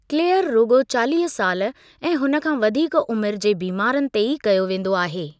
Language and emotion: Sindhi, neutral